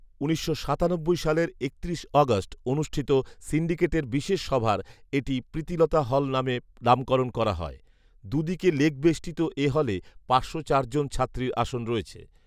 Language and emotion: Bengali, neutral